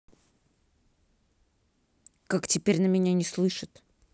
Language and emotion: Russian, angry